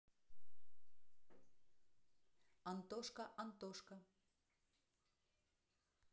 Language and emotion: Russian, neutral